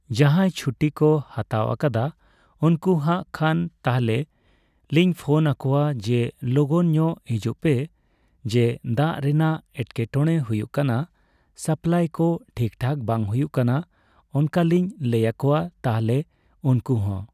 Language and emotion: Santali, neutral